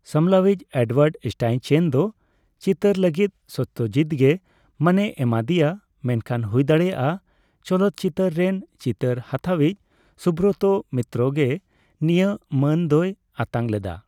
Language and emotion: Santali, neutral